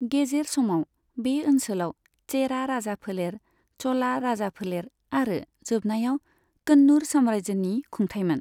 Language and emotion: Bodo, neutral